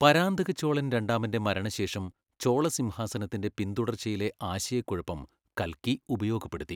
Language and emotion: Malayalam, neutral